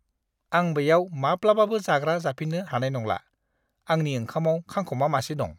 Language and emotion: Bodo, disgusted